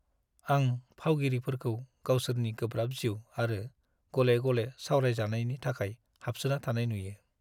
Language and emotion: Bodo, sad